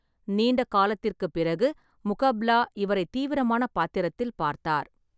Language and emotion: Tamil, neutral